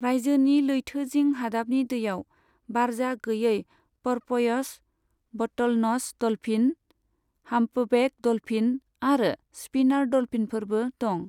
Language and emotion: Bodo, neutral